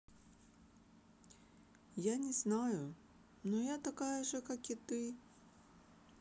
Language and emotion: Russian, sad